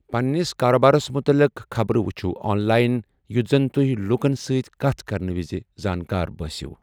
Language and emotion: Kashmiri, neutral